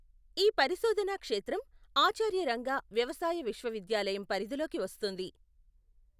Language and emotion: Telugu, neutral